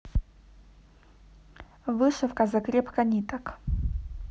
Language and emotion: Russian, neutral